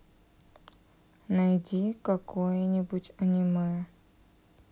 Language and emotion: Russian, sad